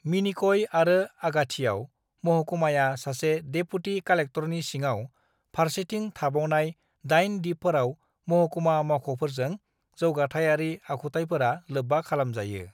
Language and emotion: Bodo, neutral